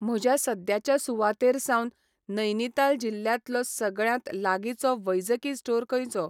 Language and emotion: Goan Konkani, neutral